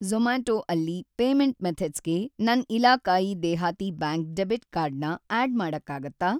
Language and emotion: Kannada, neutral